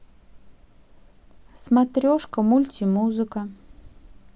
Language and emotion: Russian, neutral